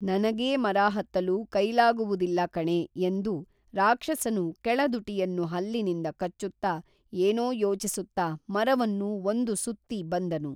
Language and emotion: Kannada, neutral